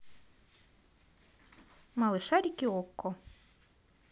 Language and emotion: Russian, positive